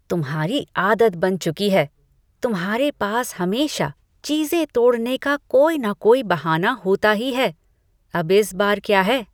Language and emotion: Hindi, disgusted